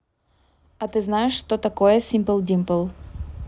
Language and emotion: Russian, neutral